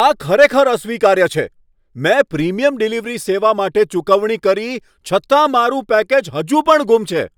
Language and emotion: Gujarati, angry